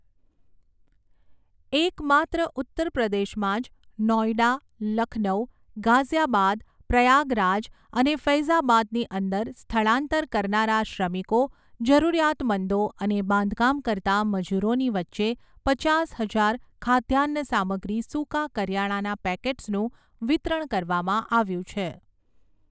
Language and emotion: Gujarati, neutral